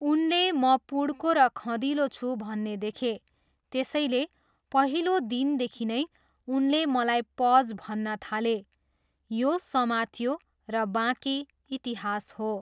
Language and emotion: Nepali, neutral